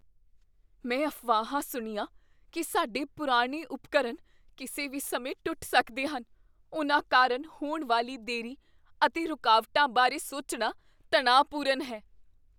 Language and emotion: Punjabi, fearful